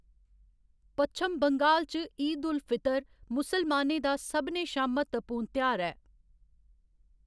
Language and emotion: Dogri, neutral